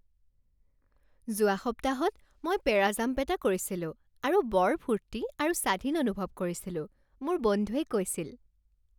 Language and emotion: Assamese, happy